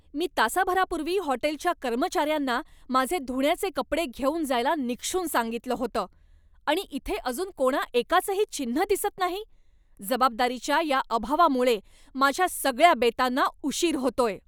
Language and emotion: Marathi, angry